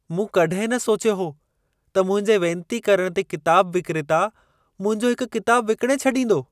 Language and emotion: Sindhi, surprised